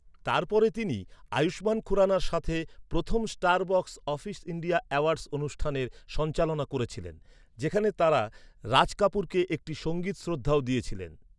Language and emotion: Bengali, neutral